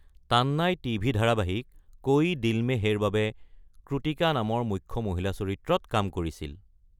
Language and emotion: Assamese, neutral